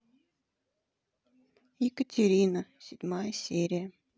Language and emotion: Russian, sad